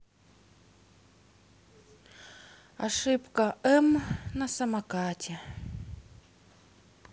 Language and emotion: Russian, sad